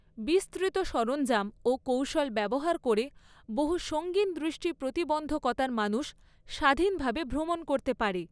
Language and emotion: Bengali, neutral